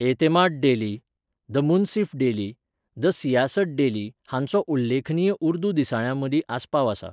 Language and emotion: Goan Konkani, neutral